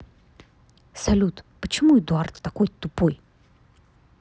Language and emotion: Russian, angry